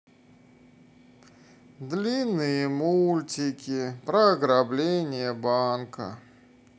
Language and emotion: Russian, sad